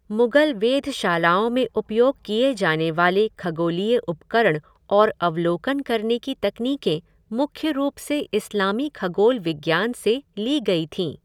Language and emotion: Hindi, neutral